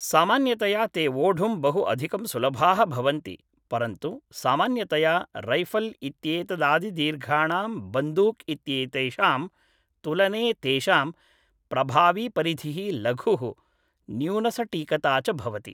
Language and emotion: Sanskrit, neutral